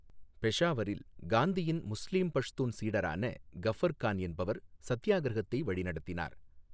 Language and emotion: Tamil, neutral